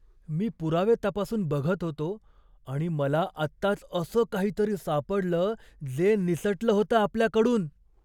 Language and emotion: Marathi, surprised